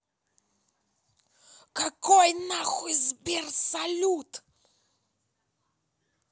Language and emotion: Russian, angry